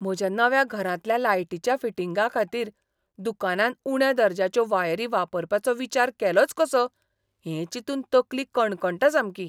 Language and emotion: Goan Konkani, disgusted